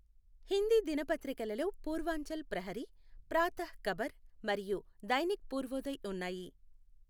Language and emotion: Telugu, neutral